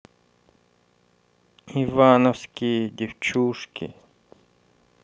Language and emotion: Russian, neutral